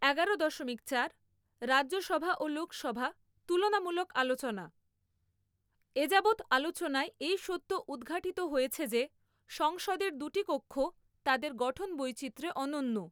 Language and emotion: Bengali, neutral